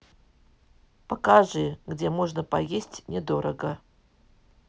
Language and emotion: Russian, neutral